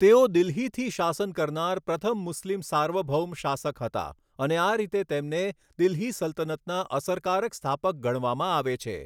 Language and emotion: Gujarati, neutral